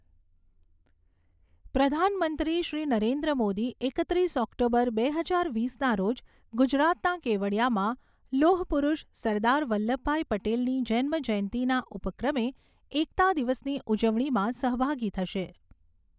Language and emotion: Gujarati, neutral